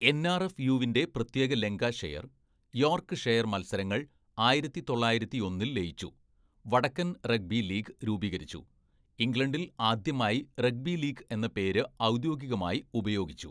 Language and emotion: Malayalam, neutral